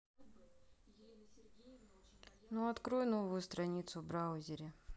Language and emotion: Russian, neutral